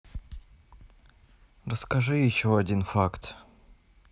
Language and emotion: Russian, neutral